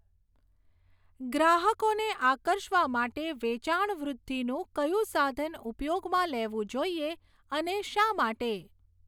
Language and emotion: Gujarati, neutral